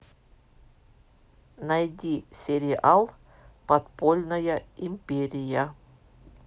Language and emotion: Russian, neutral